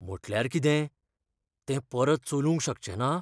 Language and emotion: Goan Konkani, fearful